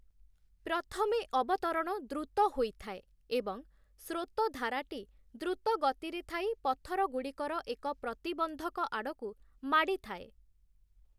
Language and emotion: Odia, neutral